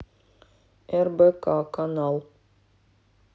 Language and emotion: Russian, neutral